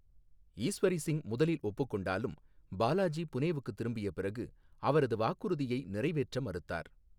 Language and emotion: Tamil, neutral